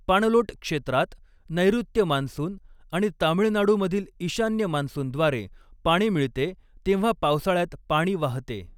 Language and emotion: Marathi, neutral